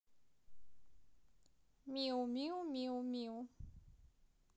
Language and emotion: Russian, positive